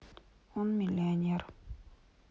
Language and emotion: Russian, sad